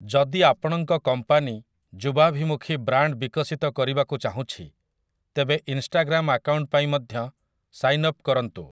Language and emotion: Odia, neutral